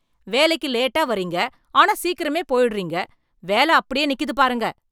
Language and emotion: Tamil, angry